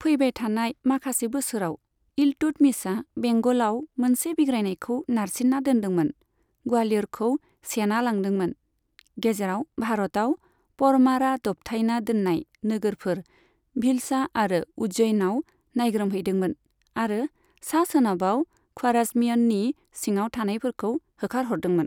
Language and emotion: Bodo, neutral